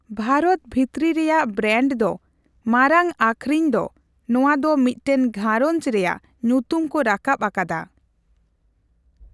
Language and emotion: Santali, neutral